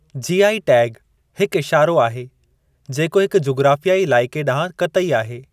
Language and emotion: Sindhi, neutral